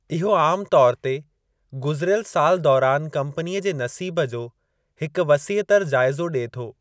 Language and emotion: Sindhi, neutral